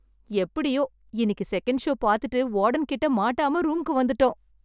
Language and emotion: Tamil, happy